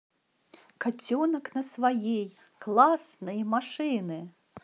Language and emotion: Russian, positive